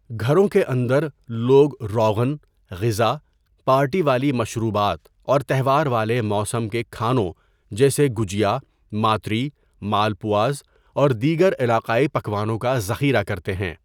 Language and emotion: Urdu, neutral